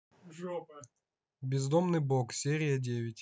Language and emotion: Russian, neutral